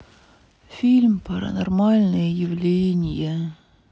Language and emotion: Russian, sad